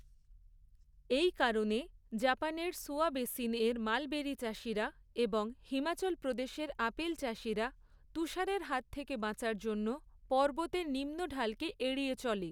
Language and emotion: Bengali, neutral